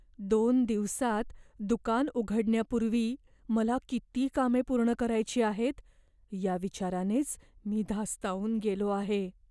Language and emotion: Marathi, fearful